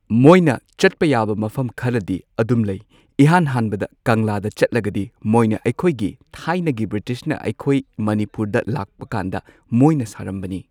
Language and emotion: Manipuri, neutral